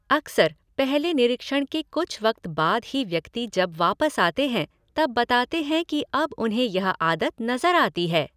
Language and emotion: Hindi, neutral